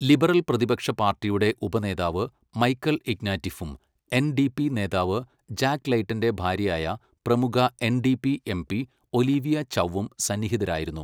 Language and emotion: Malayalam, neutral